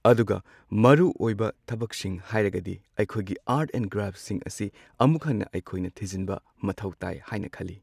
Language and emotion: Manipuri, neutral